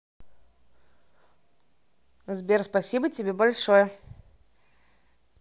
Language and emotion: Russian, positive